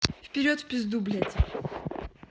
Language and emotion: Russian, angry